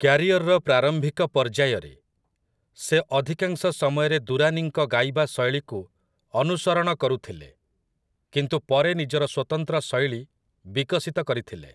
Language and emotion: Odia, neutral